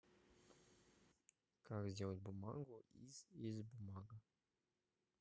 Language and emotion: Russian, neutral